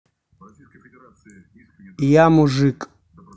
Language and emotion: Russian, neutral